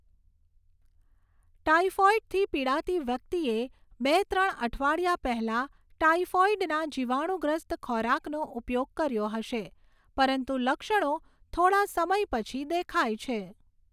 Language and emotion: Gujarati, neutral